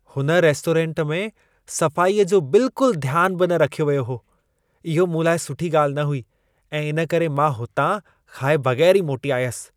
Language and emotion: Sindhi, disgusted